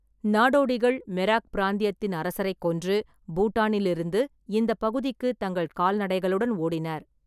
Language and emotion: Tamil, neutral